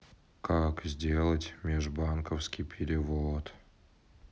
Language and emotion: Russian, sad